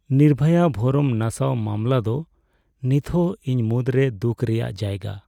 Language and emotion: Santali, sad